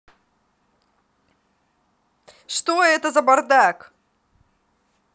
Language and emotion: Russian, angry